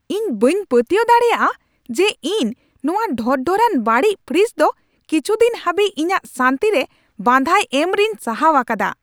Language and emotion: Santali, angry